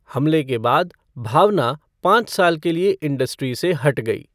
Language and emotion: Hindi, neutral